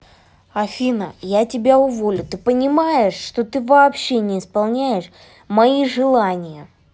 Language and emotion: Russian, angry